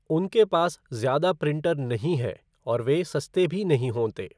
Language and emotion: Hindi, neutral